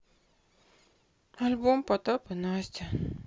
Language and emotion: Russian, sad